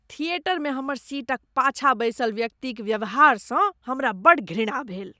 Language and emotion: Maithili, disgusted